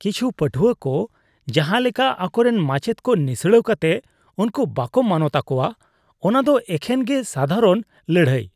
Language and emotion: Santali, disgusted